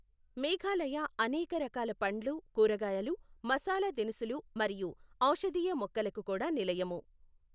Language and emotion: Telugu, neutral